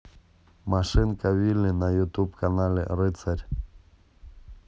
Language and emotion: Russian, neutral